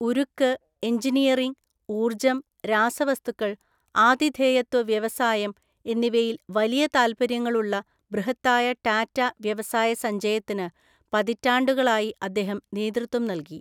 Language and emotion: Malayalam, neutral